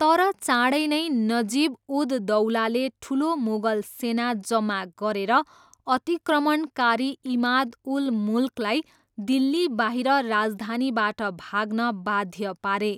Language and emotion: Nepali, neutral